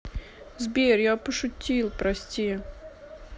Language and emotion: Russian, sad